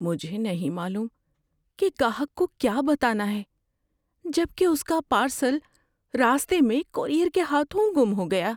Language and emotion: Urdu, fearful